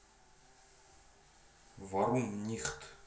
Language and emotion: Russian, neutral